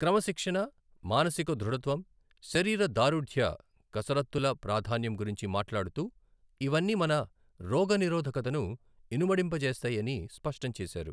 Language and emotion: Telugu, neutral